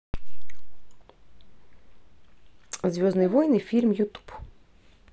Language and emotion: Russian, neutral